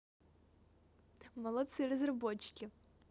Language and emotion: Russian, positive